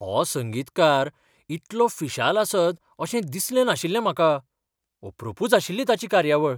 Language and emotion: Goan Konkani, surprised